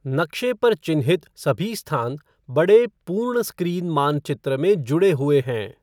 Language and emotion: Hindi, neutral